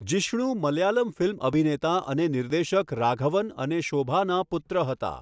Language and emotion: Gujarati, neutral